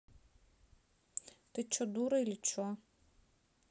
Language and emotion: Russian, angry